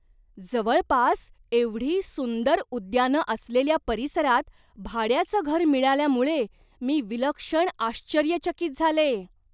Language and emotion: Marathi, surprised